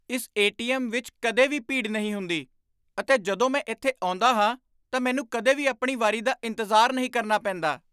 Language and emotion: Punjabi, surprised